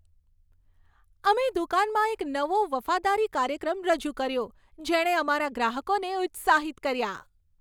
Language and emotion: Gujarati, happy